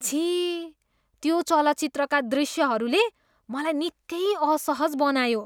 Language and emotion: Nepali, disgusted